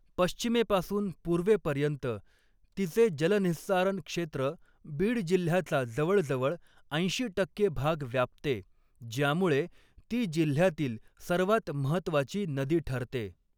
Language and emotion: Marathi, neutral